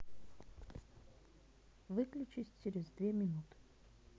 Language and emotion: Russian, neutral